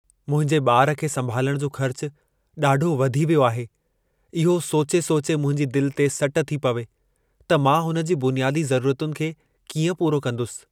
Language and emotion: Sindhi, sad